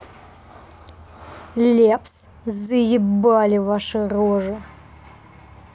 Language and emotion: Russian, angry